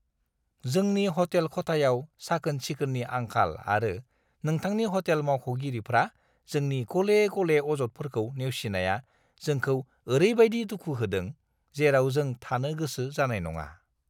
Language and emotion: Bodo, disgusted